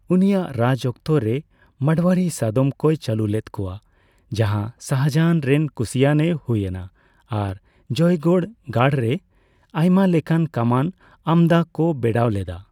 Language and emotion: Santali, neutral